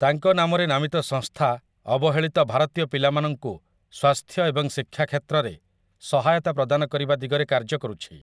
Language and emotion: Odia, neutral